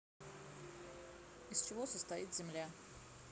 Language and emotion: Russian, neutral